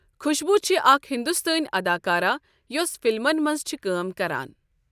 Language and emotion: Kashmiri, neutral